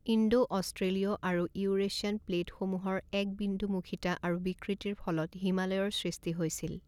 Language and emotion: Assamese, neutral